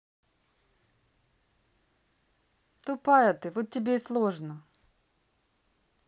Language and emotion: Russian, neutral